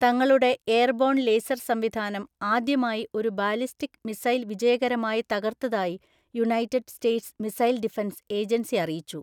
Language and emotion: Malayalam, neutral